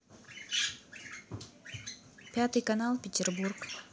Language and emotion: Russian, neutral